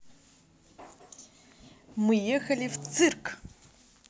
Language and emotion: Russian, positive